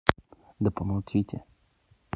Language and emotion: Russian, neutral